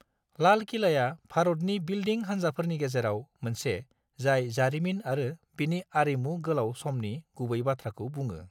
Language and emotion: Bodo, neutral